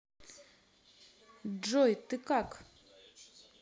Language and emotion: Russian, neutral